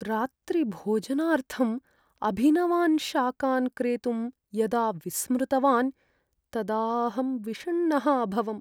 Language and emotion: Sanskrit, sad